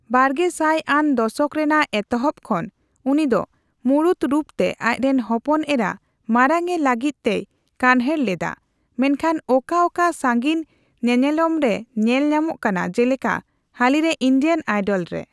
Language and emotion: Santali, neutral